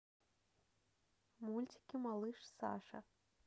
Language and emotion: Russian, neutral